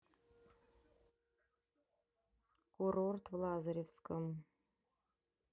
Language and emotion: Russian, neutral